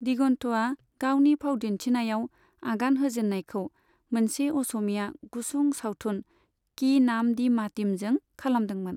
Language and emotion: Bodo, neutral